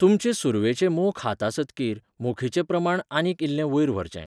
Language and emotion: Goan Konkani, neutral